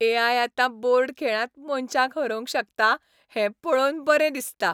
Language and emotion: Goan Konkani, happy